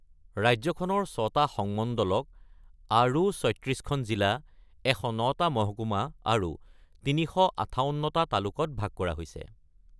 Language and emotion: Assamese, neutral